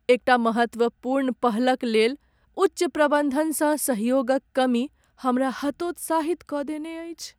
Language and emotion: Maithili, sad